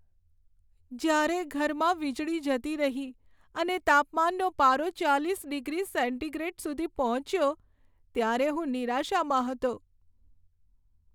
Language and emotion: Gujarati, sad